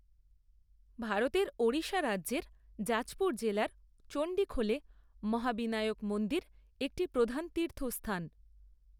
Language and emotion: Bengali, neutral